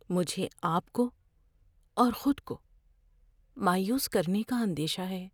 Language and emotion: Urdu, fearful